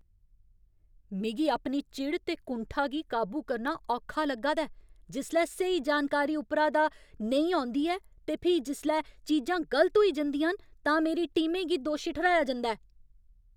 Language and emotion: Dogri, angry